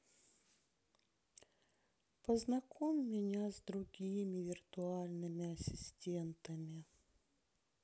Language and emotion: Russian, sad